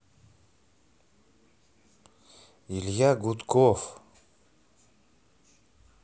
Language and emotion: Russian, neutral